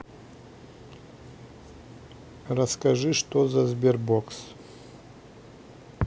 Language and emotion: Russian, neutral